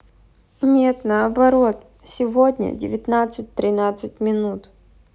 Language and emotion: Russian, neutral